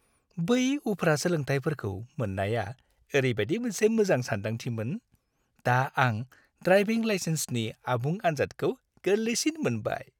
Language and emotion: Bodo, happy